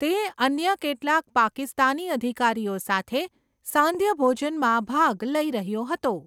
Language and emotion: Gujarati, neutral